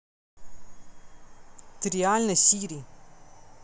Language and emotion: Russian, angry